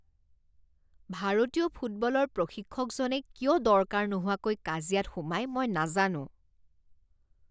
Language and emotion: Assamese, disgusted